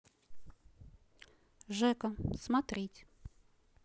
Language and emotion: Russian, neutral